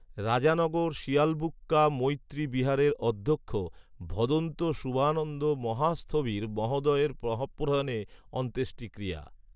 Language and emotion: Bengali, neutral